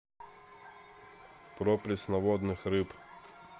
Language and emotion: Russian, neutral